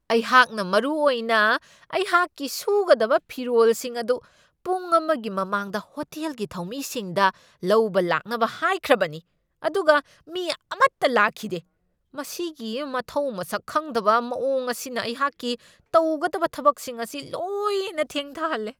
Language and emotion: Manipuri, angry